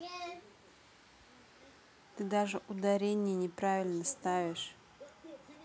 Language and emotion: Russian, neutral